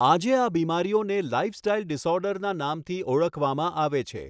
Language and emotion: Gujarati, neutral